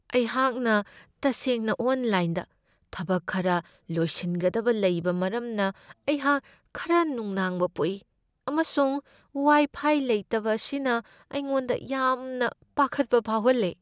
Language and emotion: Manipuri, fearful